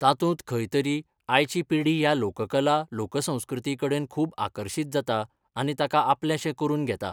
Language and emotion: Goan Konkani, neutral